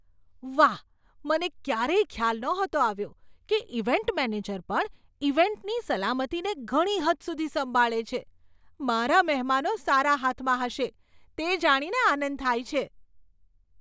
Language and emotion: Gujarati, surprised